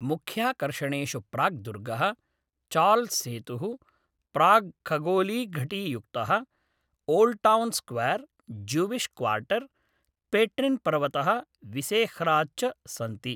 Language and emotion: Sanskrit, neutral